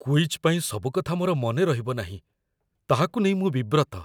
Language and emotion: Odia, fearful